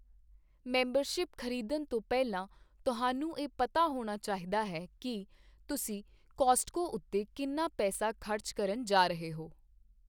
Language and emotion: Punjabi, neutral